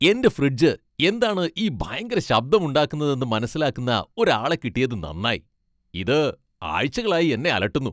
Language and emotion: Malayalam, happy